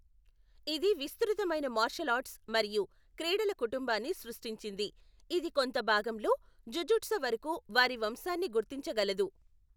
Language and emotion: Telugu, neutral